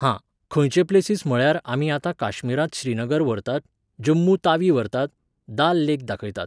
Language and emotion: Goan Konkani, neutral